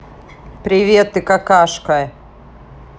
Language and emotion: Russian, angry